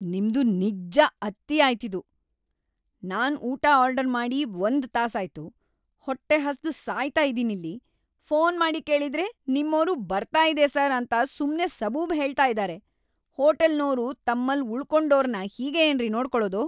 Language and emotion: Kannada, angry